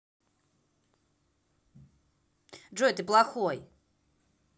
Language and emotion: Russian, angry